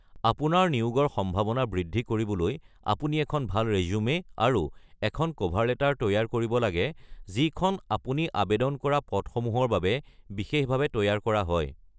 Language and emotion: Assamese, neutral